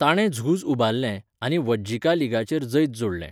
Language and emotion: Goan Konkani, neutral